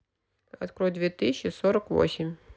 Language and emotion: Russian, neutral